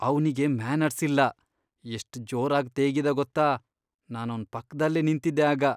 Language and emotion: Kannada, disgusted